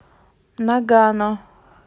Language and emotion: Russian, neutral